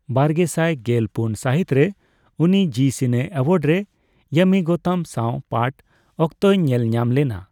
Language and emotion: Santali, neutral